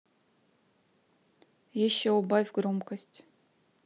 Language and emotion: Russian, neutral